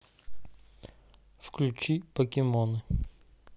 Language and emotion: Russian, neutral